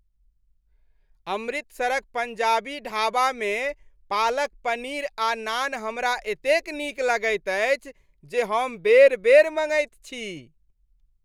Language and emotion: Maithili, happy